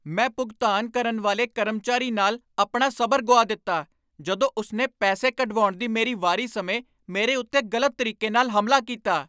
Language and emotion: Punjabi, angry